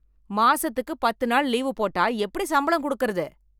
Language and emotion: Tamil, angry